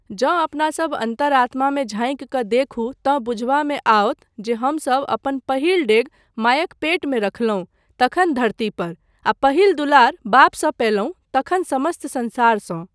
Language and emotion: Maithili, neutral